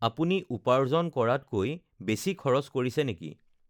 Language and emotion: Assamese, neutral